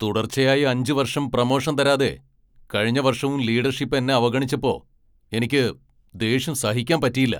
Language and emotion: Malayalam, angry